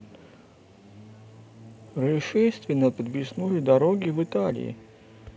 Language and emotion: Russian, neutral